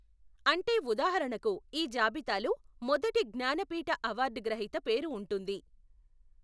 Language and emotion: Telugu, neutral